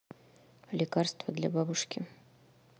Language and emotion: Russian, neutral